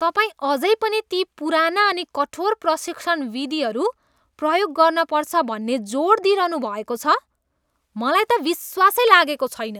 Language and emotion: Nepali, disgusted